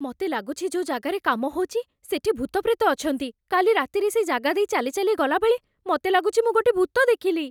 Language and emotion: Odia, fearful